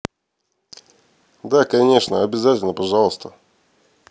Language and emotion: Russian, neutral